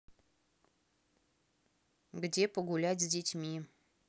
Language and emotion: Russian, neutral